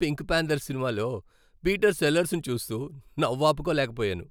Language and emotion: Telugu, happy